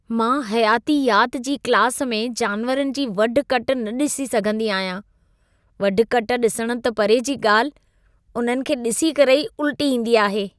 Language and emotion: Sindhi, disgusted